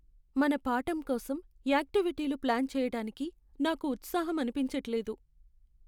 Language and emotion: Telugu, sad